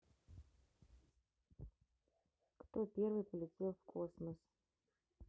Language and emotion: Russian, neutral